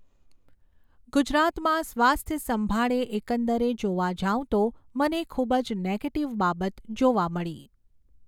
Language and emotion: Gujarati, neutral